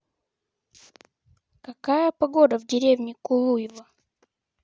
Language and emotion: Russian, neutral